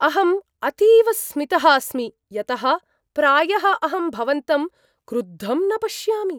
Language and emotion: Sanskrit, surprised